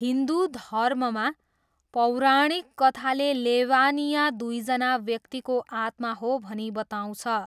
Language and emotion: Nepali, neutral